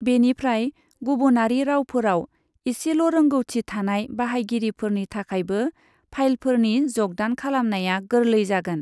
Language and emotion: Bodo, neutral